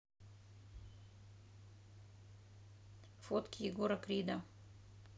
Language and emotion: Russian, neutral